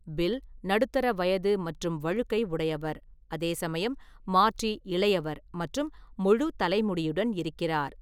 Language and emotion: Tamil, neutral